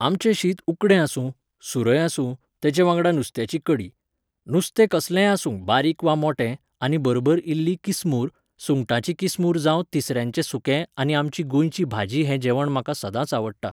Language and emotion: Goan Konkani, neutral